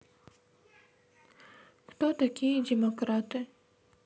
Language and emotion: Russian, neutral